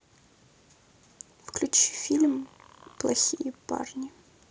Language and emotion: Russian, sad